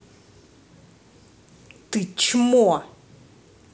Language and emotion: Russian, angry